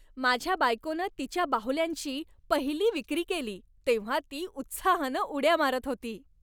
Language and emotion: Marathi, happy